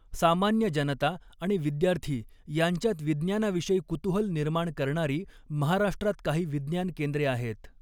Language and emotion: Marathi, neutral